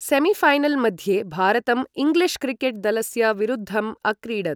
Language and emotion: Sanskrit, neutral